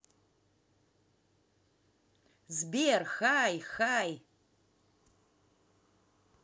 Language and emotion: Russian, positive